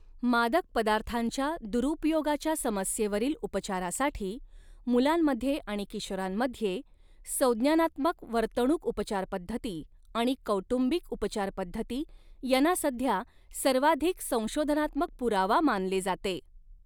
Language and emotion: Marathi, neutral